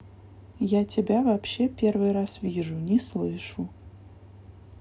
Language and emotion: Russian, neutral